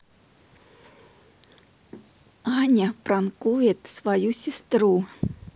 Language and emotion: Russian, neutral